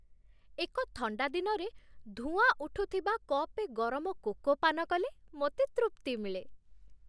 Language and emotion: Odia, happy